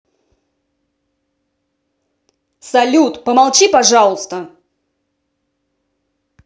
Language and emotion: Russian, angry